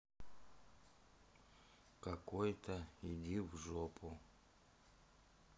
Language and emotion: Russian, sad